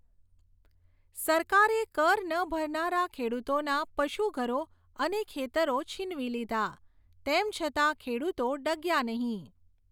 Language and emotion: Gujarati, neutral